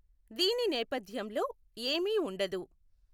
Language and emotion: Telugu, neutral